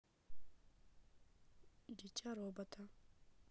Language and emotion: Russian, neutral